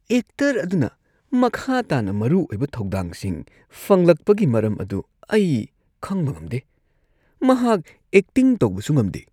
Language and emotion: Manipuri, disgusted